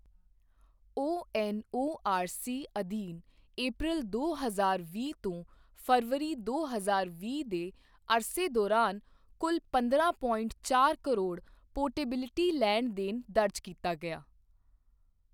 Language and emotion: Punjabi, neutral